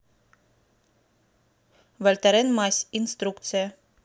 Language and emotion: Russian, neutral